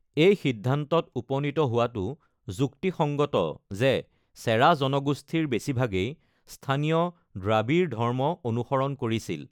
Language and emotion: Assamese, neutral